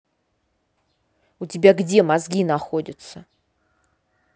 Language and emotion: Russian, angry